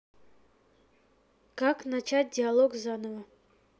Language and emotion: Russian, neutral